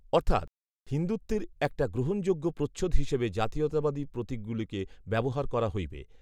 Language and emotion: Bengali, neutral